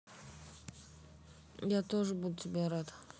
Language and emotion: Russian, neutral